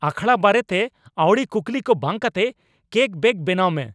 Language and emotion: Santali, angry